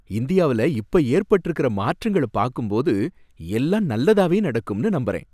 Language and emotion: Tamil, happy